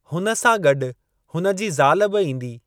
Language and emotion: Sindhi, neutral